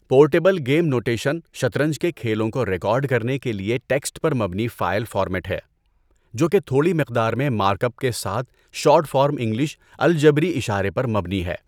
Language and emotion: Urdu, neutral